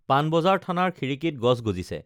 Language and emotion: Assamese, neutral